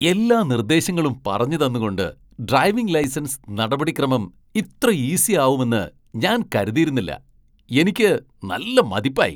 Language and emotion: Malayalam, surprised